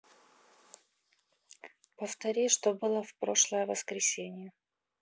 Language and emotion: Russian, neutral